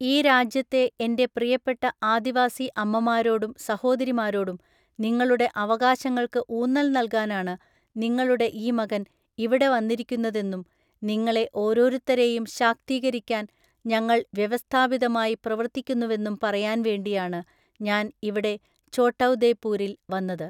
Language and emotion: Malayalam, neutral